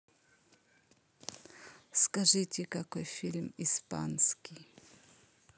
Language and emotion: Russian, neutral